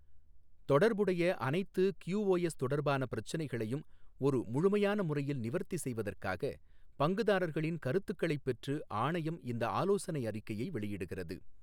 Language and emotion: Tamil, neutral